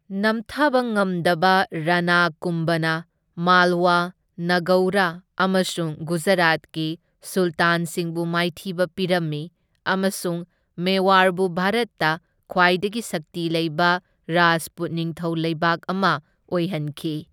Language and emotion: Manipuri, neutral